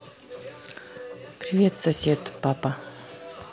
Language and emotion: Russian, neutral